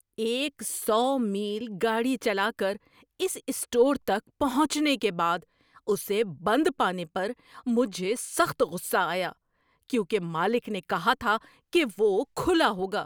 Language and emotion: Urdu, angry